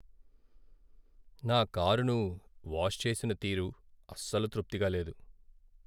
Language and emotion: Telugu, sad